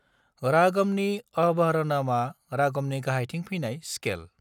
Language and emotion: Bodo, neutral